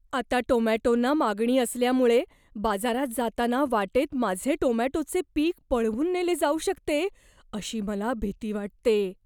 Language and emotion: Marathi, fearful